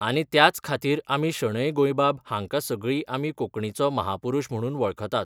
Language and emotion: Goan Konkani, neutral